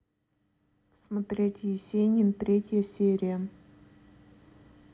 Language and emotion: Russian, neutral